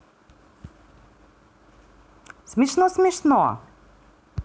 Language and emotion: Russian, positive